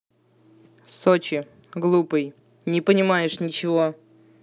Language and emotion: Russian, angry